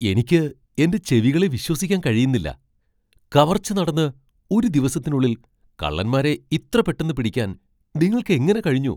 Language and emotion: Malayalam, surprised